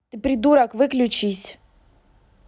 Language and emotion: Russian, angry